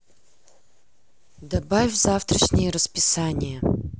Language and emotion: Russian, neutral